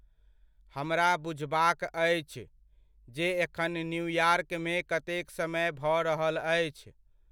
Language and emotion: Maithili, neutral